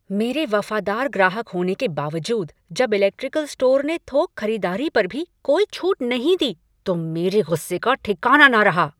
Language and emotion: Hindi, angry